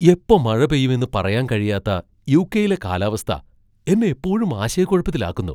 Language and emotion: Malayalam, surprised